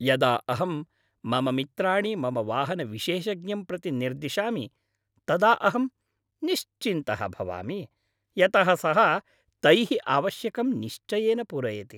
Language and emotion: Sanskrit, happy